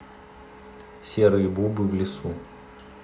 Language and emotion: Russian, neutral